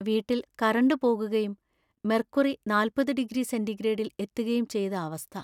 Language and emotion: Malayalam, sad